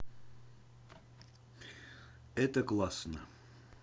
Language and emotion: Russian, neutral